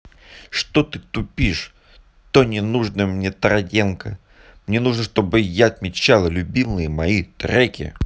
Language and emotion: Russian, angry